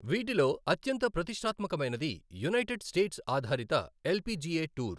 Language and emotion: Telugu, neutral